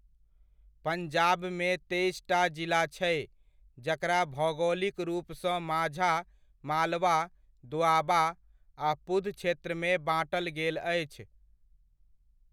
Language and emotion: Maithili, neutral